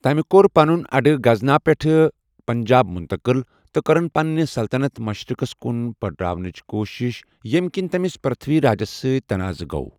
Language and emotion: Kashmiri, neutral